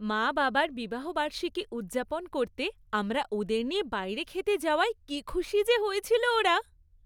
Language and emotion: Bengali, happy